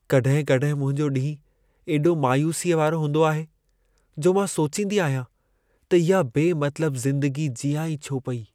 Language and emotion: Sindhi, sad